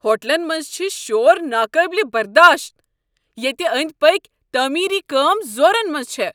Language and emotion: Kashmiri, angry